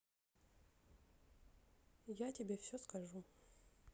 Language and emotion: Russian, sad